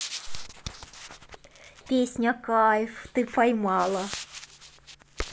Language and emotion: Russian, positive